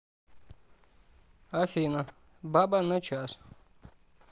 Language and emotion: Russian, neutral